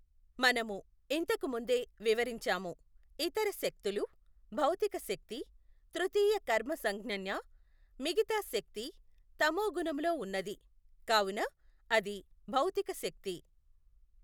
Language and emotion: Telugu, neutral